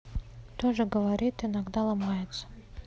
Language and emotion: Russian, neutral